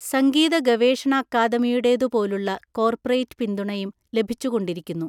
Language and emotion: Malayalam, neutral